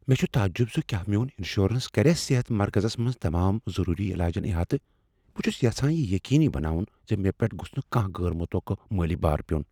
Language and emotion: Kashmiri, fearful